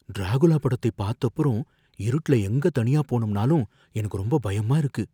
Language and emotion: Tamil, fearful